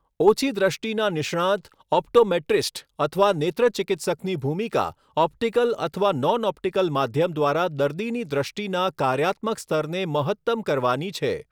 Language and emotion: Gujarati, neutral